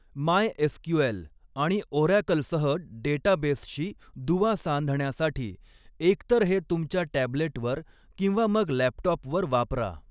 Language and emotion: Marathi, neutral